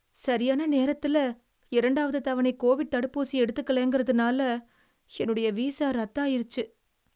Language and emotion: Tamil, sad